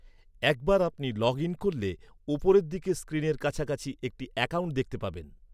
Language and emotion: Bengali, neutral